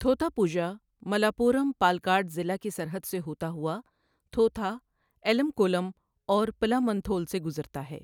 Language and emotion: Urdu, neutral